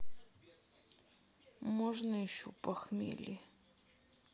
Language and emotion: Russian, sad